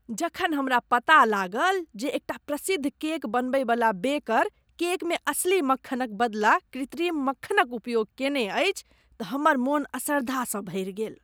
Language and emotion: Maithili, disgusted